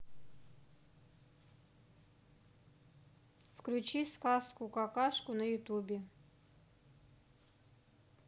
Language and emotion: Russian, neutral